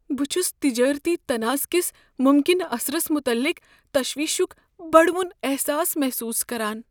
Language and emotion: Kashmiri, fearful